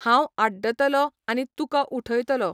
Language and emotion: Goan Konkani, neutral